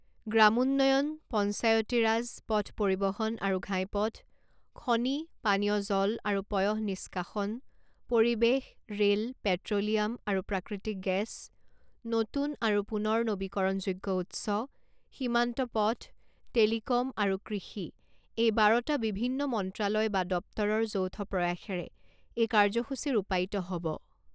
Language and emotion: Assamese, neutral